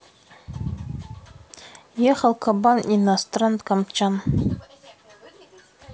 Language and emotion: Russian, neutral